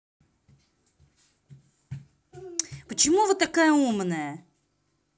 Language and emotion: Russian, angry